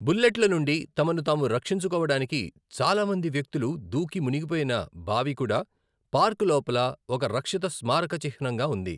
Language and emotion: Telugu, neutral